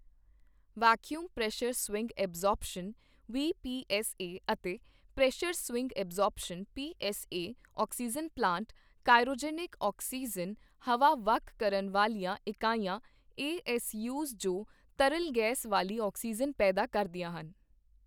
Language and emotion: Punjabi, neutral